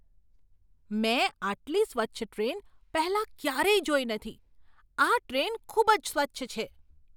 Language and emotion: Gujarati, surprised